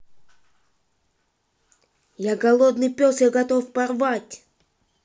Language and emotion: Russian, angry